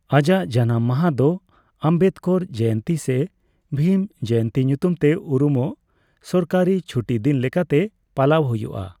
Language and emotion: Santali, neutral